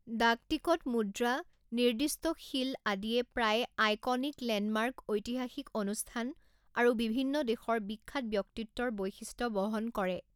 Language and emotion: Assamese, neutral